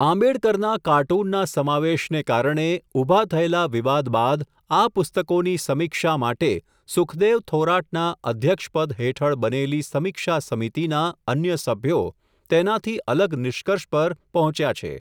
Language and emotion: Gujarati, neutral